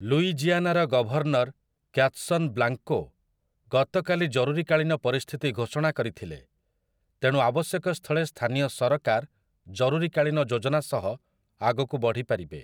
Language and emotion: Odia, neutral